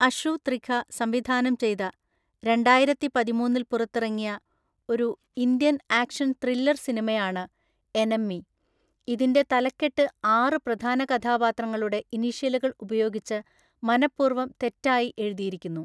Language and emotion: Malayalam, neutral